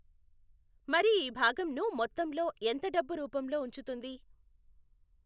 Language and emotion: Telugu, neutral